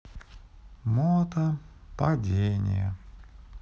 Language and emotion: Russian, sad